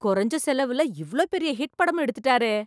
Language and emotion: Tamil, surprised